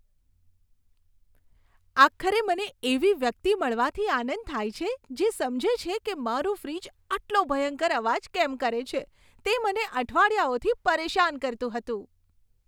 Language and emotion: Gujarati, happy